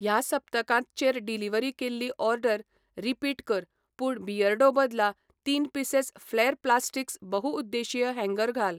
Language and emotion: Goan Konkani, neutral